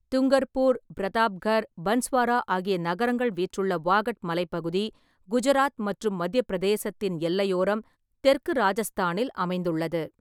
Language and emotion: Tamil, neutral